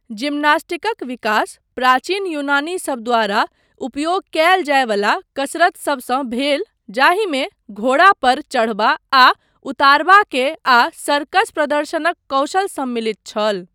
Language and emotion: Maithili, neutral